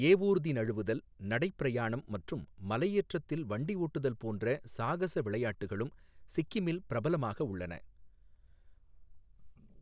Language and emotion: Tamil, neutral